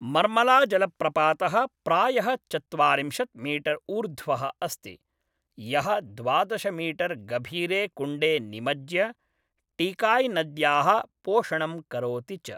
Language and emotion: Sanskrit, neutral